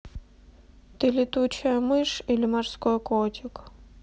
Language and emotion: Russian, neutral